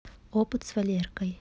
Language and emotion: Russian, neutral